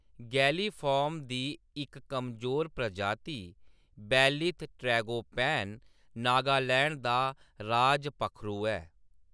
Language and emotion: Dogri, neutral